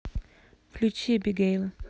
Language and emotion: Russian, neutral